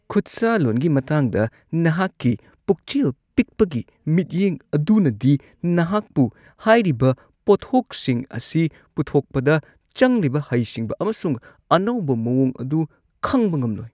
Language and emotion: Manipuri, disgusted